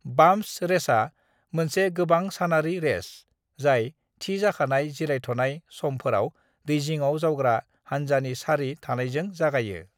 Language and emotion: Bodo, neutral